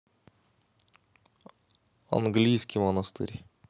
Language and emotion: Russian, neutral